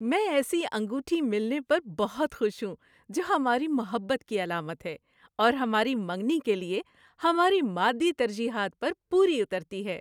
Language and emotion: Urdu, happy